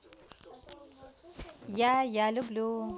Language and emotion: Russian, positive